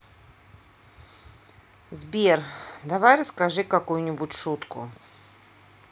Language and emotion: Russian, neutral